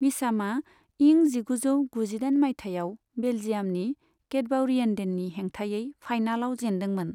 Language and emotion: Bodo, neutral